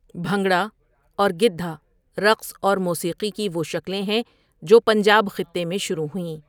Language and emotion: Urdu, neutral